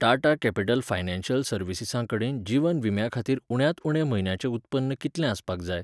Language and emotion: Goan Konkani, neutral